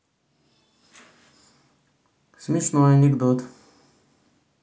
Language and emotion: Russian, neutral